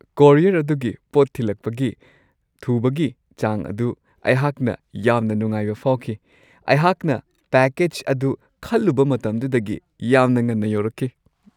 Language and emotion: Manipuri, happy